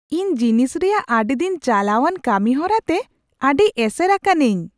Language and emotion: Santali, surprised